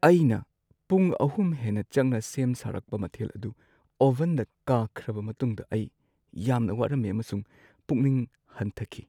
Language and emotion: Manipuri, sad